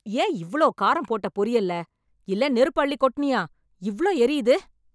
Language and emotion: Tamil, angry